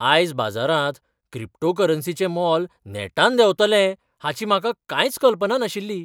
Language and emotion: Goan Konkani, surprised